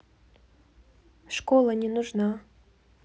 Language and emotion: Russian, neutral